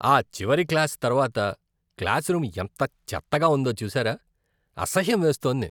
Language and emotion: Telugu, disgusted